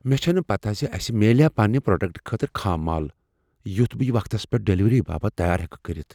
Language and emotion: Kashmiri, fearful